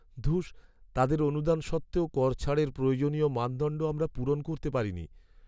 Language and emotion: Bengali, sad